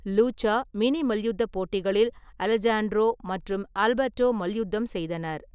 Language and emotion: Tamil, neutral